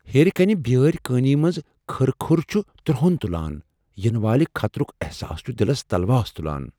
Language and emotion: Kashmiri, fearful